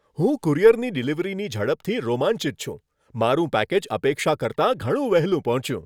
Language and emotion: Gujarati, happy